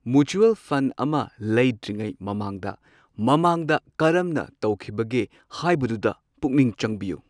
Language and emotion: Manipuri, neutral